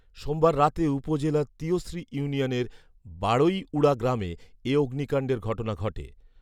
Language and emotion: Bengali, neutral